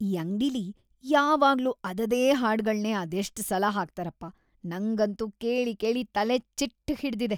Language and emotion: Kannada, disgusted